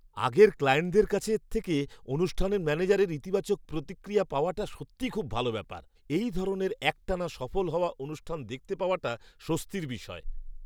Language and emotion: Bengali, surprised